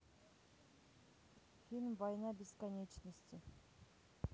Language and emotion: Russian, neutral